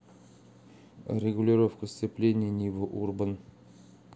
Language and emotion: Russian, neutral